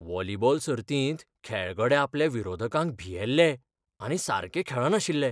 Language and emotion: Goan Konkani, fearful